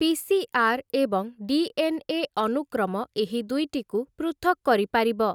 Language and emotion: Odia, neutral